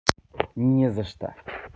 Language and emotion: Russian, neutral